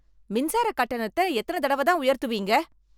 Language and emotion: Tamil, angry